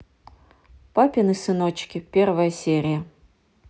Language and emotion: Russian, neutral